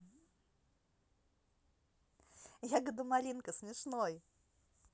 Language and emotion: Russian, positive